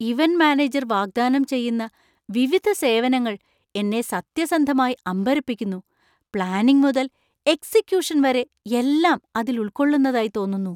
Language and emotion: Malayalam, surprised